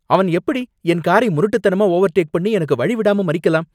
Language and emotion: Tamil, angry